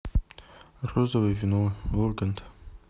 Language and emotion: Russian, neutral